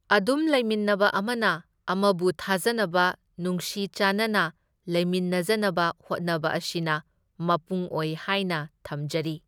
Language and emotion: Manipuri, neutral